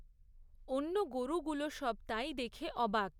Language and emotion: Bengali, neutral